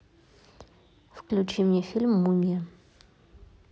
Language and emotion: Russian, neutral